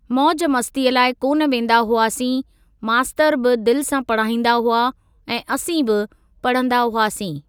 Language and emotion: Sindhi, neutral